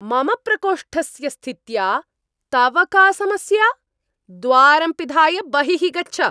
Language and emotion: Sanskrit, angry